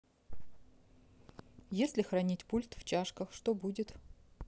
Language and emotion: Russian, neutral